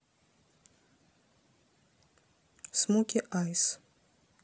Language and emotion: Russian, neutral